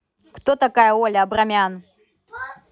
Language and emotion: Russian, angry